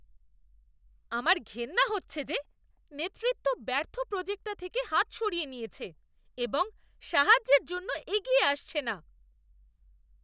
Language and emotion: Bengali, disgusted